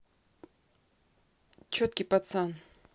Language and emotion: Russian, neutral